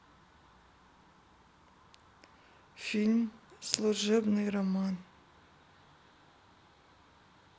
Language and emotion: Russian, sad